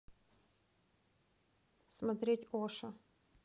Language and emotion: Russian, neutral